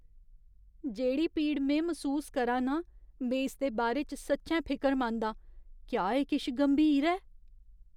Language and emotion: Dogri, fearful